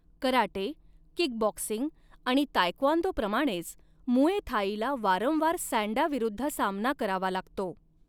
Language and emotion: Marathi, neutral